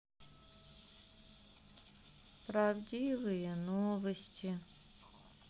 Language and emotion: Russian, sad